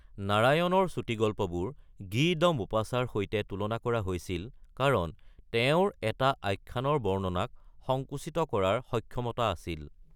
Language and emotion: Assamese, neutral